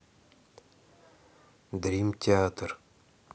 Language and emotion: Russian, neutral